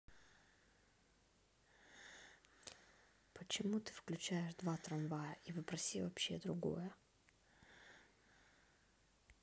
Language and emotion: Russian, neutral